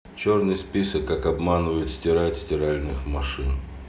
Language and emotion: Russian, neutral